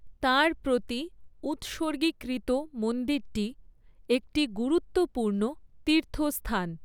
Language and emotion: Bengali, neutral